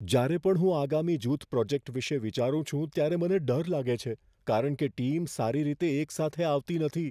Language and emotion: Gujarati, fearful